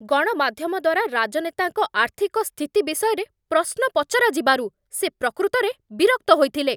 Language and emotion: Odia, angry